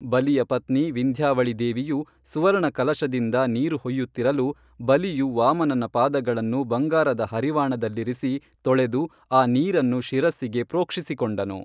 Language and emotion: Kannada, neutral